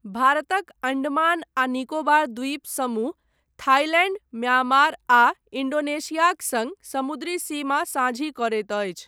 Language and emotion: Maithili, neutral